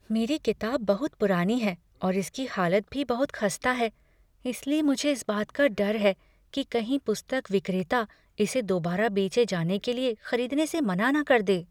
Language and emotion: Hindi, fearful